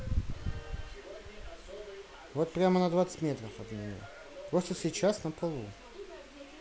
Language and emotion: Russian, neutral